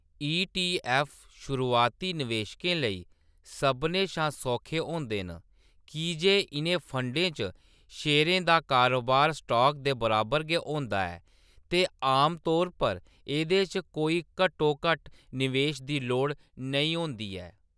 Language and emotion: Dogri, neutral